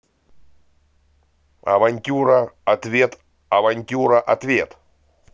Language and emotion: Russian, positive